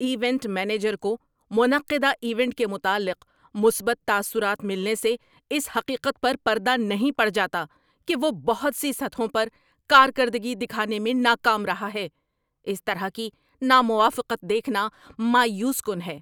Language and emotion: Urdu, angry